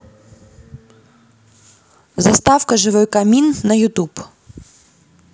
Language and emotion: Russian, neutral